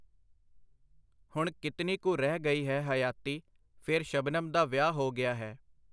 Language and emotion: Punjabi, neutral